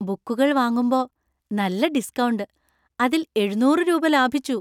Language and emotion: Malayalam, happy